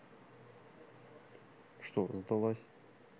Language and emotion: Russian, neutral